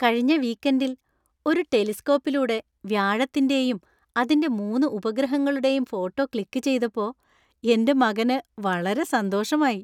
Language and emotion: Malayalam, happy